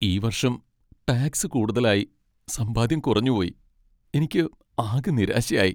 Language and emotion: Malayalam, sad